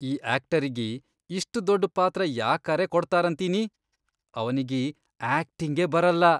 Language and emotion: Kannada, disgusted